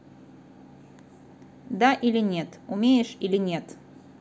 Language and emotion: Russian, neutral